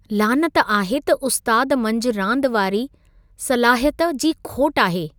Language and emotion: Sindhi, disgusted